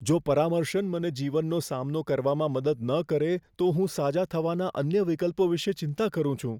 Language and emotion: Gujarati, fearful